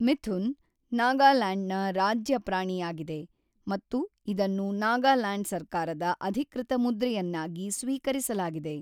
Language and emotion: Kannada, neutral